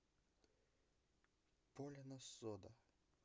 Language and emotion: Russian, neutral